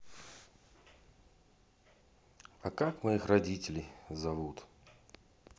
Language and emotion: Russian, sad